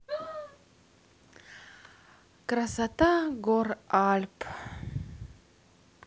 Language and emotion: Russian, positive